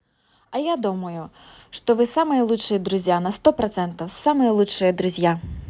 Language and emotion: Russian, positive